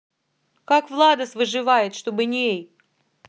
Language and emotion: Russian, angry